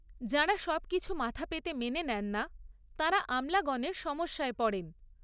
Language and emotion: Bengali, neutral